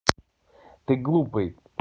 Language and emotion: Russian, neutral